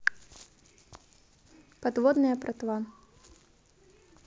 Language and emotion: Russian, neutral